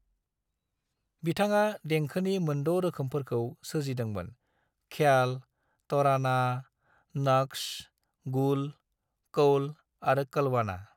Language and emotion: Bodo, neutral